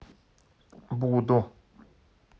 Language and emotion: Russian, neutral